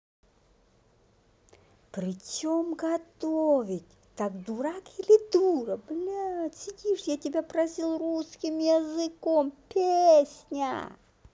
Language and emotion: Russian, angry